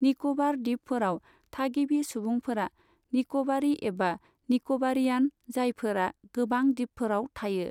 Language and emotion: Bodo, neutral